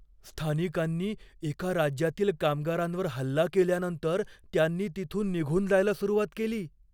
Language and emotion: Marathi, fearful